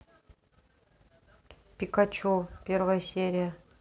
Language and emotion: Russian, neutral